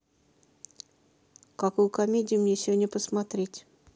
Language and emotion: Russian, neutral